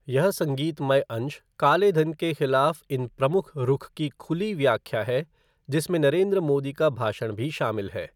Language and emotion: Hindi, neutral